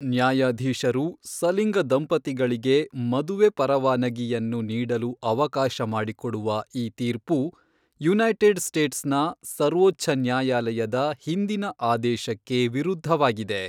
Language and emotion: Kannada, neutral